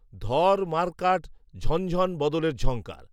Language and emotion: Bengali, neutral